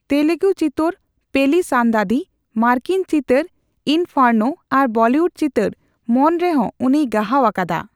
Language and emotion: Santali, neutral